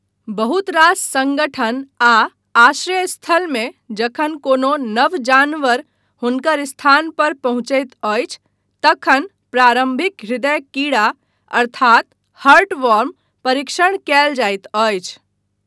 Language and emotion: Maithili, neutral